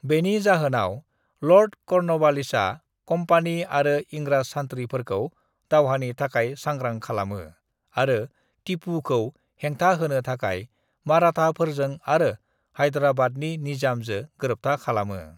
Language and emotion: Bodo, neutral